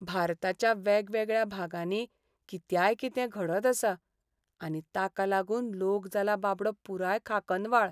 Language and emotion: Goan Konkani, sad